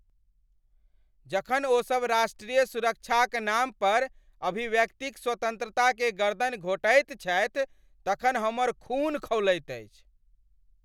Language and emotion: Maithili, angry